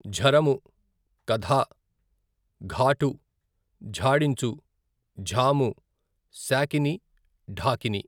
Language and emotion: Telugu, neutral